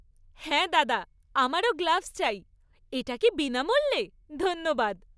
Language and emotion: Bengali, happy